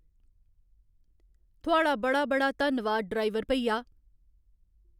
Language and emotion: Dogri, neutral